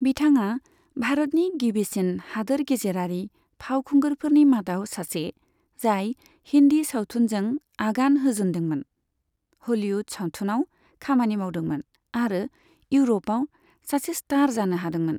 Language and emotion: Bodo, neutral